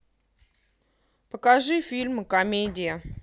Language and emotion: Russian, positive